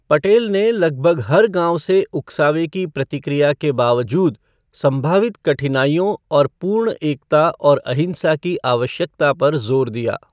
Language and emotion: Hindi, neutral